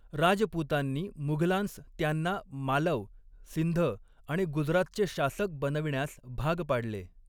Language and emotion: Marathi, neutral